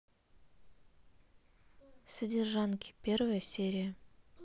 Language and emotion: Russian, neutral